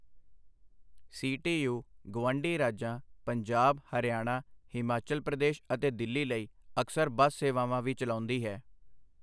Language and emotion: Punjabi, neutral